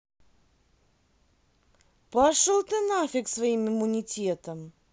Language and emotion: Russian, angry